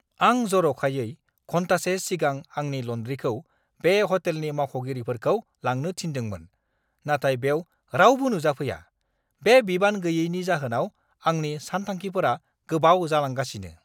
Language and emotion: Bodo, angry